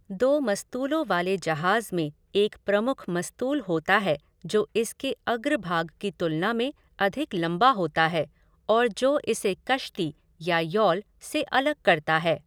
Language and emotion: Hindi, neutral